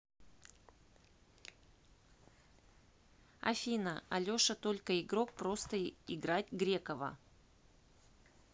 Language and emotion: Russian, neutral